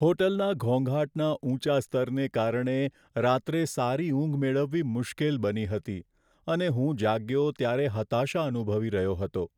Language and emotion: Gujarati, sad